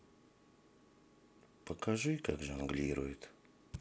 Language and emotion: Russian, sad